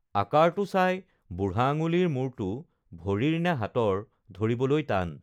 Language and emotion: Assamese, neutral